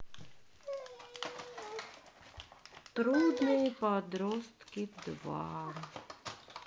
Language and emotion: Russian, sad